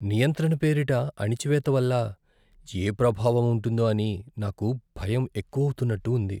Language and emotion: Telugu, fearful